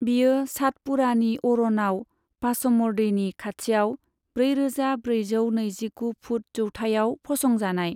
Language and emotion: Bodo, neutral